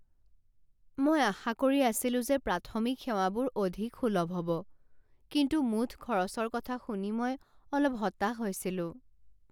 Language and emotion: Assamese, sad